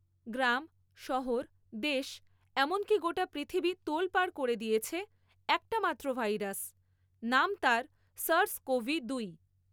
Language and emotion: Bengali, neutral